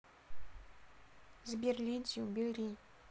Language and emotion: Russian, neutral